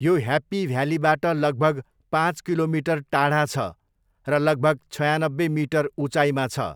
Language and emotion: Nepali, neutral